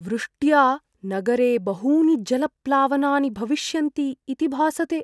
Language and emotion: Sanskrit, fearful